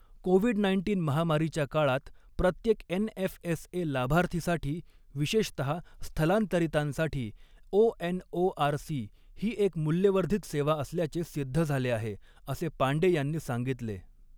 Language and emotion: Marathi, neutral